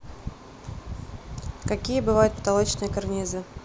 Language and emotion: Russian, neutral